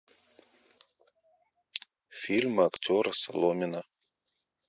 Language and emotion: Russian, neutral